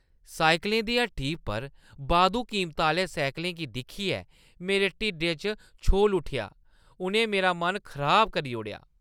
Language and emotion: Dogri, disgusted